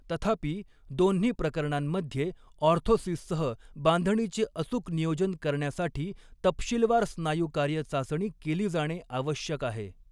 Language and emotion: Marathi, neutral